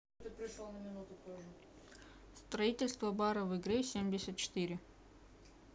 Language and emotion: Russian, neutral